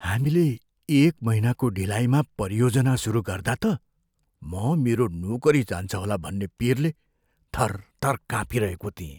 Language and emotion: Nepali, fearful